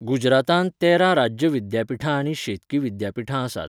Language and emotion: Goan Konkani, neutral